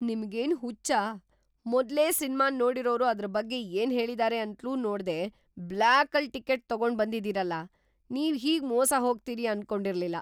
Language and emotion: Kannada, surprised